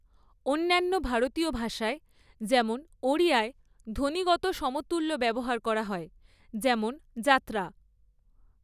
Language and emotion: Bengali, neutral